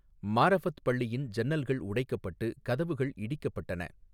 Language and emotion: Tamil, neutral